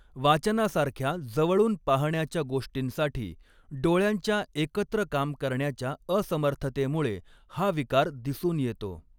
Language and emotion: Marathi, neutral